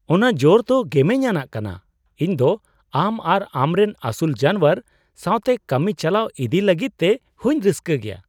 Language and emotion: Santali, surprised